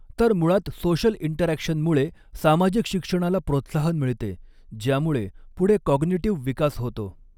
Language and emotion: Marathi, neutral